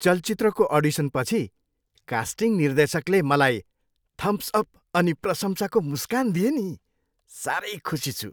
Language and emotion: Nepali, happy